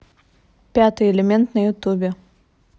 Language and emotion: Russian, neutral